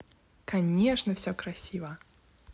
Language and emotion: Russian, positive